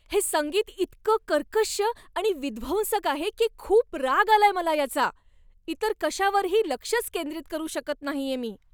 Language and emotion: Marathi, angry